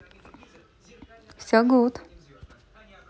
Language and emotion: Russian, positive